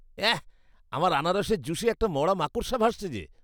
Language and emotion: Bengali, disgusted